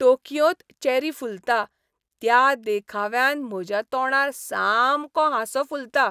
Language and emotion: Goan Konkani, happy